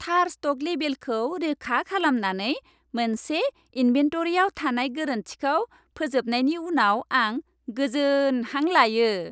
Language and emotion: Bodo, happy